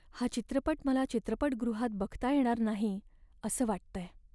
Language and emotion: Marathi, sad